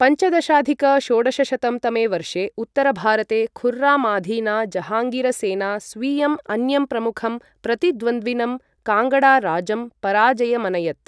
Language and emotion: Sanskrit, neutral